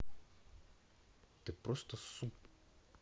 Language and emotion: Russian, neutral